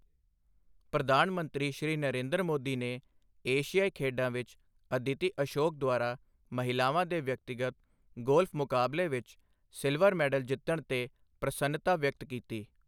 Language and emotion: Punjabi, neutral